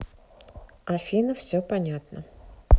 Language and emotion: Russian, neutral